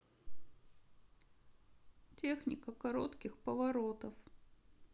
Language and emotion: Russian, sad